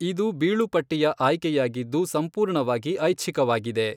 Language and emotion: Kannada, neutral